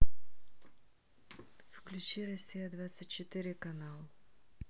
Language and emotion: Russian, neutral